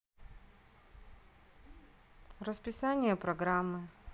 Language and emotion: Russian, neutral